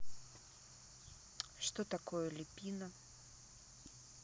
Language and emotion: Russian, neutral